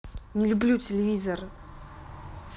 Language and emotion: Russian, angry